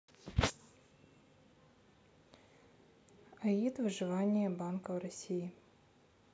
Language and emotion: Russian, neutral